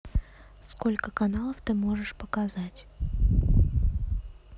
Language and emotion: Russian, neutral